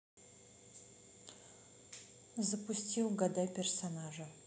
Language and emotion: Russian, neutral